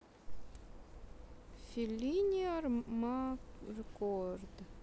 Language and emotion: Russian, neutral